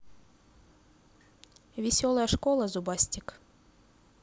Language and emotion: Russian, neutral